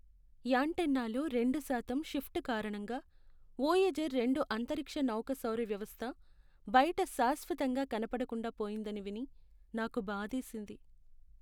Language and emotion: Telugu, sad